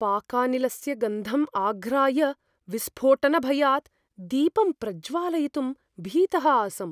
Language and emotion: Sanskrit, fearful